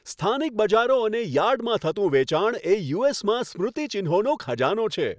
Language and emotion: Gujarati, happy